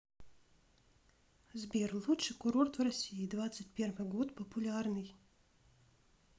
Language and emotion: Russian, neutral